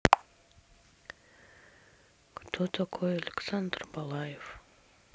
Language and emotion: Russian, sad